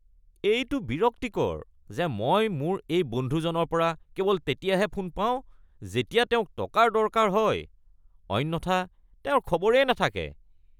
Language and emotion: Assamese, disgusted